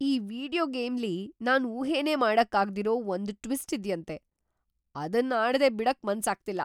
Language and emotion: Kannada, surprised